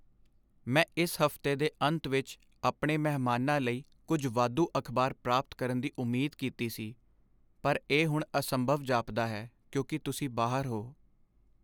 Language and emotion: Punjabi, sad